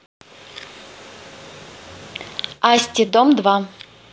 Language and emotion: Russian, neutral